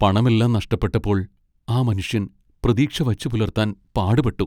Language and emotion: Malayalam, sad